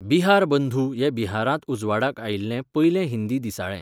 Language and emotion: Goan Konkani, neutral